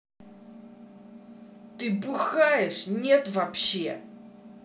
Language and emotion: Russian, angry